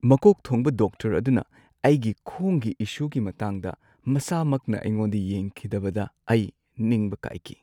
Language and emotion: Manipuri, sad